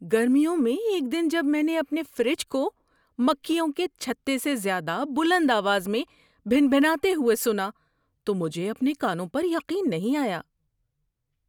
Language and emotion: Urdu, surprised